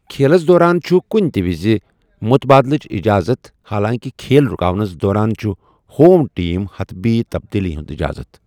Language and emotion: Kashmiri, neutral